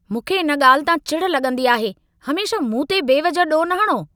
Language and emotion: Sindhi, angry